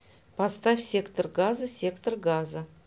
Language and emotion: Russian, neutral